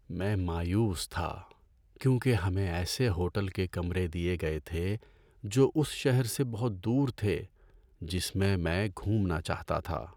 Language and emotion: Urdu, sad